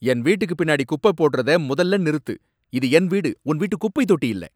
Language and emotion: Tamil, angry